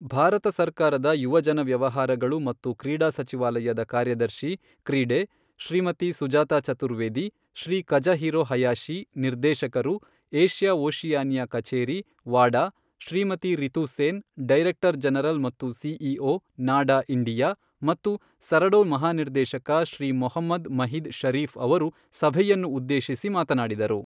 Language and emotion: Kannada, neutral